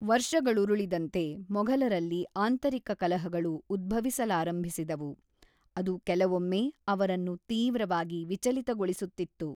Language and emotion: Kannada, neutral